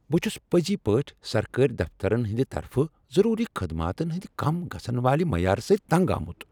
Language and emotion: Kashmiri, angry